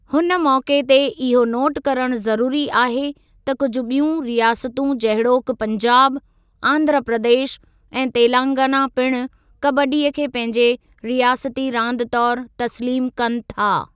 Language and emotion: Sindhi, neutral